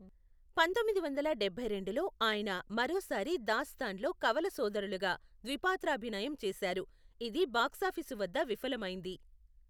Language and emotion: Telugu, neutral